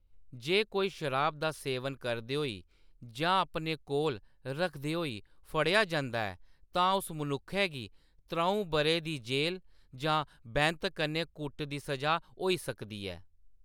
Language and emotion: Dogri, neutral